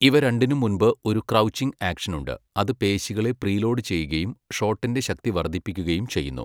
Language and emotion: Malayalam, neutral